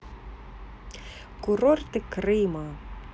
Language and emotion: Russian, neutral